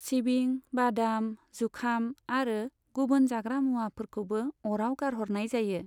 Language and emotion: Bodo, neutral